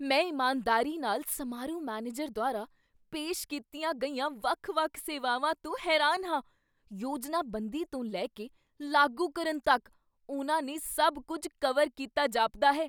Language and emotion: Punjabi, surprised